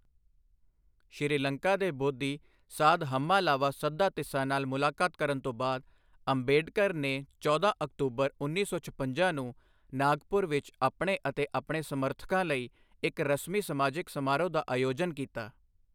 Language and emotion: Punjabi, neutral